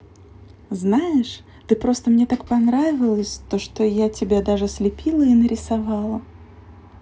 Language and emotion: Russian, positive